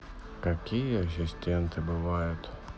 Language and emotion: Russian, sad